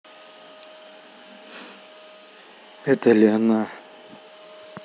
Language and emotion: Russian, neutral